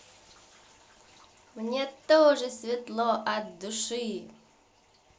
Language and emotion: Russian, positive